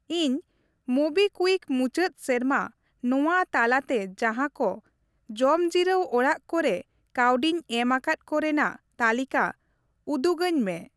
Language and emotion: Santali, neutral